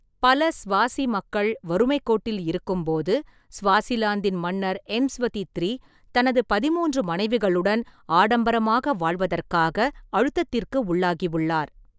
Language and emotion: Tamil, neutral